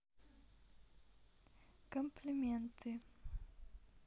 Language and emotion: Russian, neutral